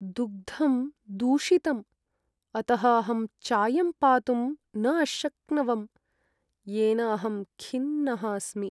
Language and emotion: Sanskrit, sad